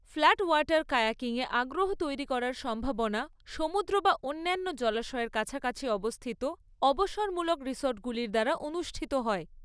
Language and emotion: Bengali, neutral